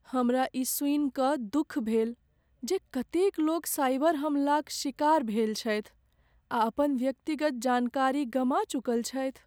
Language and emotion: Maithili, sad